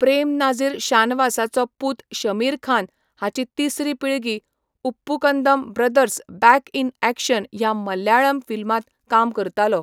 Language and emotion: Goan Konkani, neutral